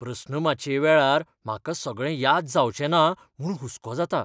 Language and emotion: Goan Konkani, fearful